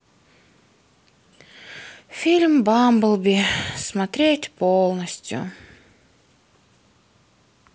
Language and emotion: Russian, sad